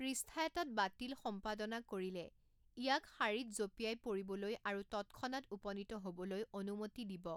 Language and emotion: Assamese, neutral